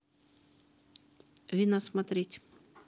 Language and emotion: Russian, neutral